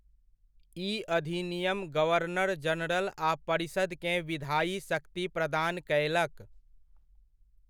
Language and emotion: Maithili, neutral